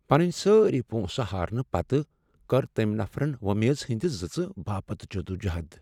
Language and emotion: Kashmiri, sad